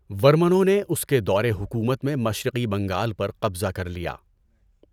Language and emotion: Urdu, neutral